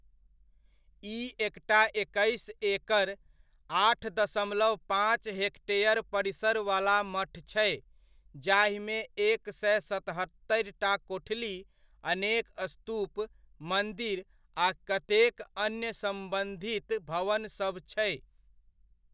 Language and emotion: Maithili, neutral